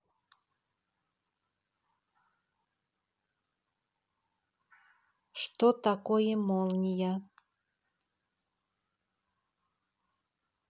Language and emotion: Russian, neutral